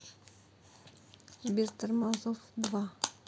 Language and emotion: Russian, sad